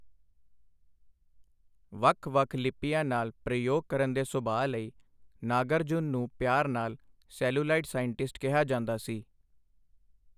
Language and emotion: Punjabi, neutral